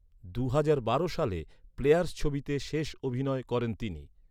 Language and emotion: Bengali, neutral